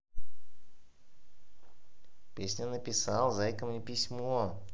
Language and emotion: Russian, positive